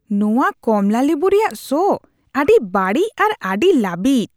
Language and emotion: Santali, disgusted